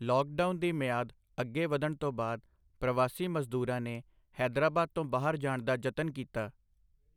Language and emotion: Punjabi, neutral